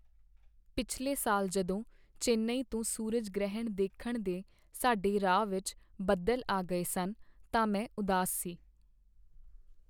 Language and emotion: Punjabi, sad